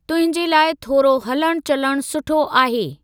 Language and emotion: Sindhi, neutral